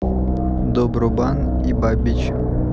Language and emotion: Russian, neutral